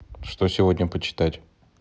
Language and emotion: Russian, neutral